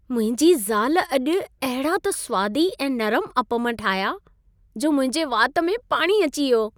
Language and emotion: Sindhi, happy